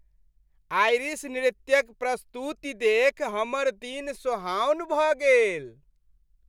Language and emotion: Maithili, happy